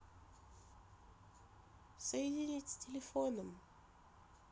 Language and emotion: Russian, neutral